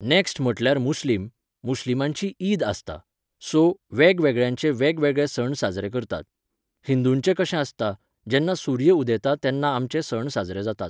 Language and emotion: Goan Konkani, neutral